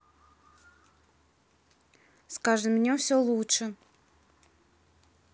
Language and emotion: Russian, neutral